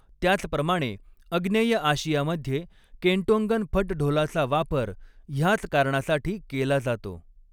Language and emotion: Marathi, neutral